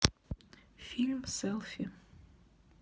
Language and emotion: Russian, neutral